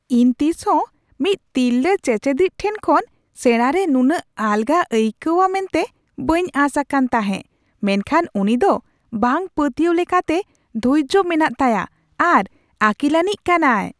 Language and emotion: Santali, surprised